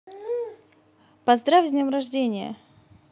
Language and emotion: Russian, positive